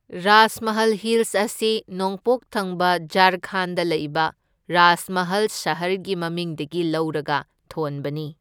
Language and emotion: Manipuri, neutral